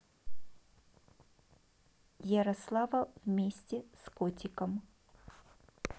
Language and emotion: Russian, neutral